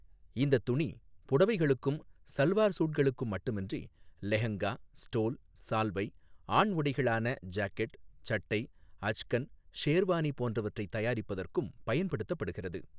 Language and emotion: Tamil, neutral